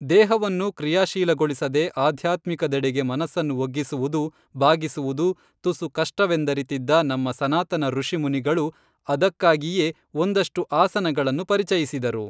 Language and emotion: Kannada, neutral